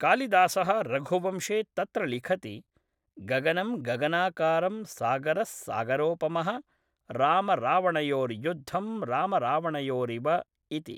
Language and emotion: Sanskrit, neutral